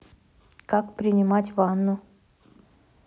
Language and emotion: Russian, neutral